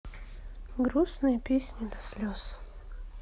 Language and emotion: Russian, sad